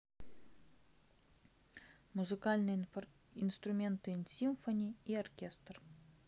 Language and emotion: Russian, neutral